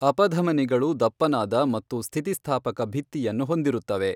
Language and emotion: Kannada, neutral